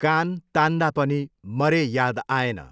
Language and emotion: Nepali, neutral